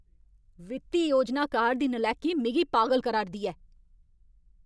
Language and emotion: Dogri, angry